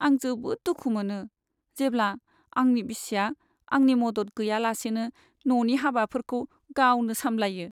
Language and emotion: Bodo, sad